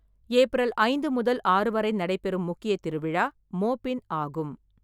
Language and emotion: Tamil, neutral